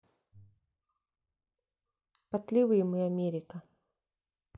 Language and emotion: Russian, neutral